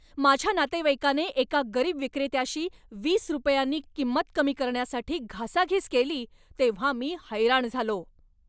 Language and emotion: Marathi, angry